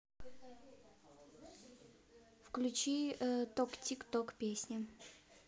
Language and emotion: Russian, neutral